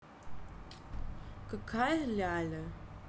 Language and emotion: Russian, neutral